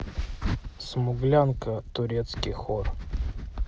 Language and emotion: Russian, neutral